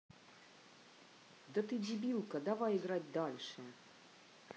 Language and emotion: Russian, angry